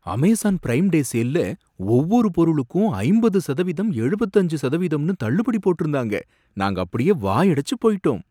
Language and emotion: Tamil, surprised